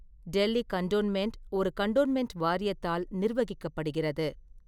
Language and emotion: Tamil, neutral